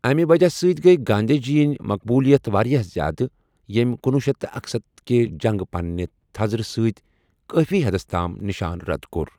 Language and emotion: Kashmiri, neutral